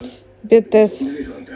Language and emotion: Russian, neutral